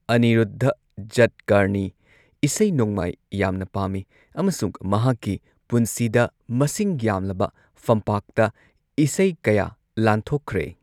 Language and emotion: Manipuri, neutral